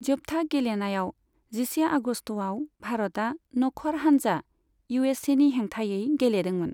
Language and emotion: Bodo, neutral